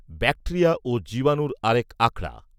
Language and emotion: Bengali, neutral